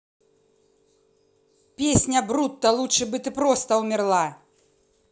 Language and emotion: Russian, angry